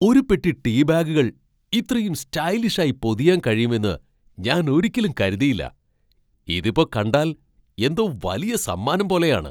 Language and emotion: Malayalam, surprised